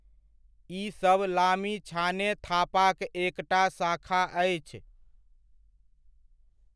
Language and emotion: Maithili, neutral